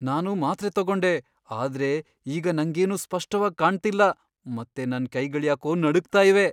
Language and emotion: Kannada, fearful